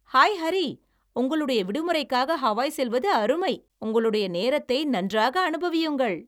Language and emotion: Tamil, happy